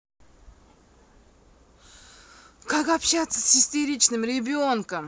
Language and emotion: Russian, angry